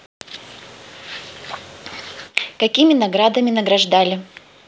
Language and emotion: Russian, neutral